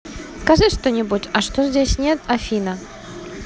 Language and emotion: Russian, positive